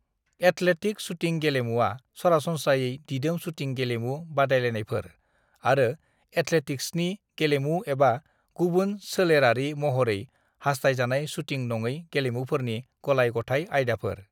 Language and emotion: Bodo, neutral